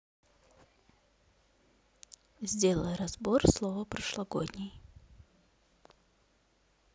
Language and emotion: Russian, neutral